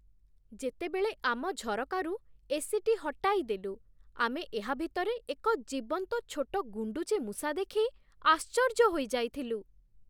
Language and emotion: Odia, surprised